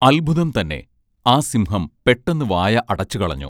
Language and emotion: Malayalam, neutral